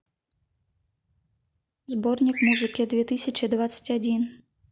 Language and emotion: Russian, neutral